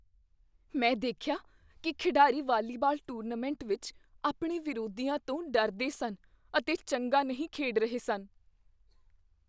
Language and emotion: Punjabi, fearful